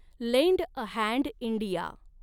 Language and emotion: Marathi, neutral